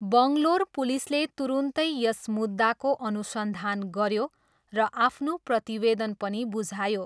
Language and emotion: Nepali, neutral